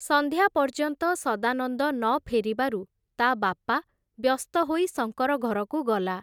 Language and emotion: Odia, neutral